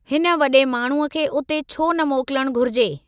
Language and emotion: Sindhi, neutral